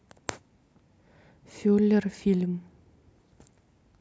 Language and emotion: Russian, neutral